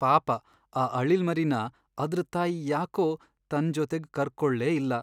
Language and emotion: Kannada, sad